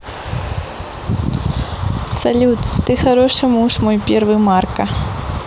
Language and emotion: Russian, positive